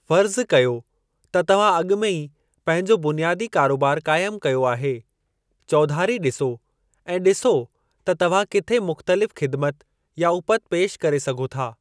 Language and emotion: Sindhi, neutral